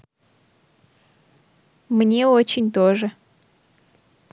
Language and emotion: Russian, positive